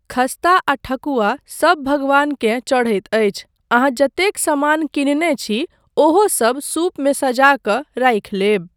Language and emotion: Maithili, neutral